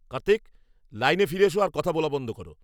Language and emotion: Bengali, angry